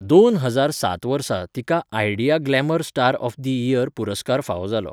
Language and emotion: Goan Konkani, neutral